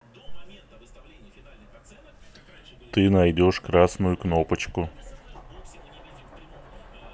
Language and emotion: Russian, neutral